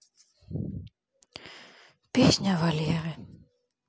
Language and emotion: Russian, sad